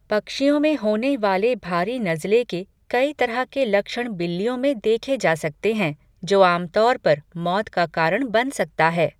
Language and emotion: Hindi, neutral